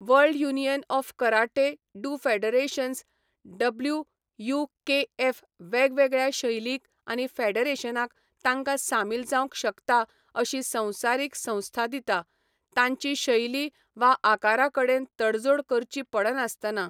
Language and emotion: Goan Konkani, neutral